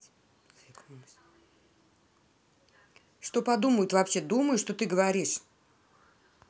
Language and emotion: Russian, angry